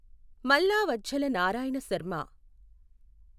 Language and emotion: Telugu, neutral